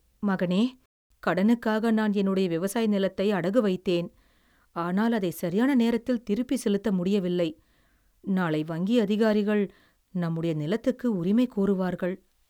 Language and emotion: Tamil, sad